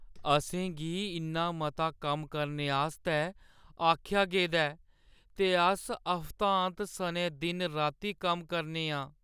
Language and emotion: Dogri, sad